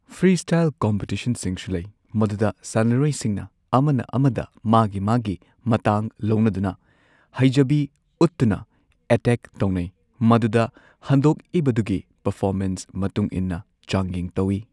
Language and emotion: Manipuri, neutral